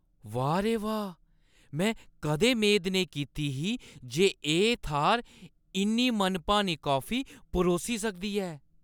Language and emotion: Dogri, surprised